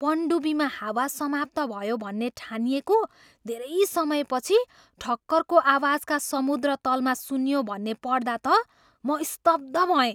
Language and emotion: Nepali, surprised